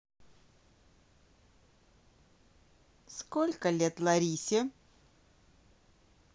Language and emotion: Russian, neutral